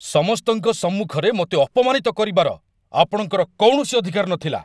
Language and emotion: Odia, angry